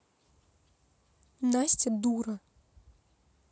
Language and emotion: Russian, angry